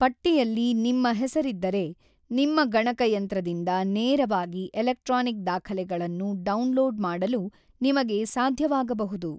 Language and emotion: Kannada, neutral